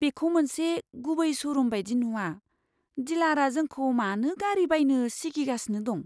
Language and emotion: Bodo, fearful